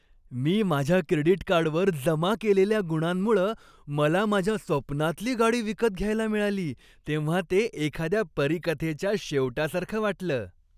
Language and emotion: Marathi, happy